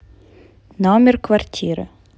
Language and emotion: Russian, neutral